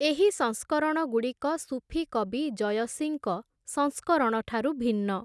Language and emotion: Odia, neutral